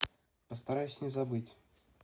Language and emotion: Russian, neutral